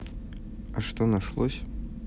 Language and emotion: Russian, neutral